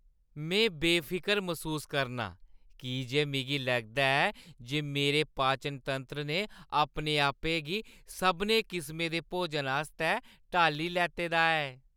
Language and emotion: Dogri, happy